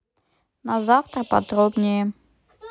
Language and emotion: Russian, neutral